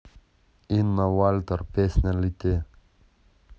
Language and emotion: Russian, neutral